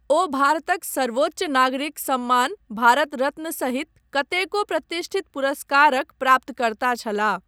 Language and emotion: Maithili, neutral